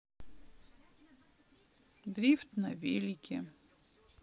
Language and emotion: Russian, sad